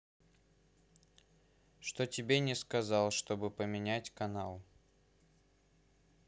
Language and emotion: Russian, neutral